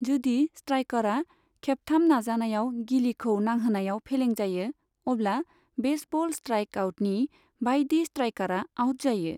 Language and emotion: Bodo, neutral